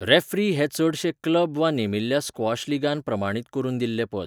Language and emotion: Goan Konkani, neutral